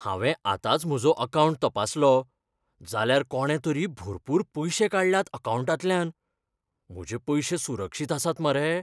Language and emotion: Goan Konkani, fearful